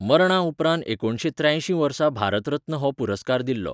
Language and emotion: Goan Konkani, neutral